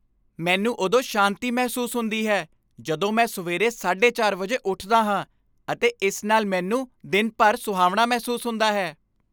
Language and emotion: Punjabi, happy